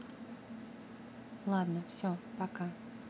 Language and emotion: Russian, neutral